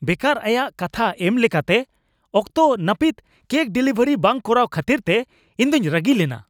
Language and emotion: Santali, angry